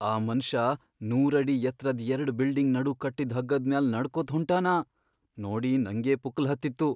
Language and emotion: Kannada, fearful